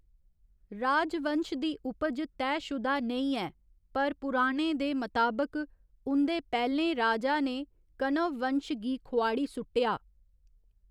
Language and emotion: Dogri, neutral